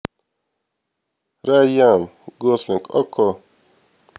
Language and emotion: Russian, neutral